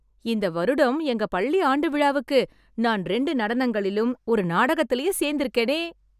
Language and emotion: Tamil, happy